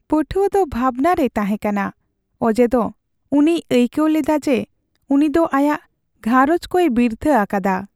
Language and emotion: Santali, sad